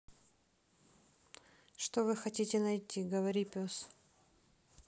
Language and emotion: Russian, neutral